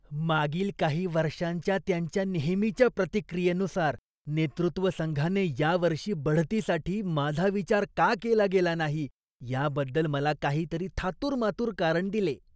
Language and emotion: Marathi, disgusted